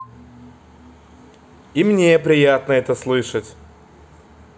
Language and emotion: Russian, positive